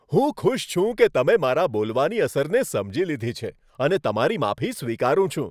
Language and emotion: Gujarati, happy